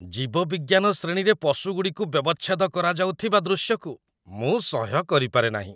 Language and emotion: Odia, disgusted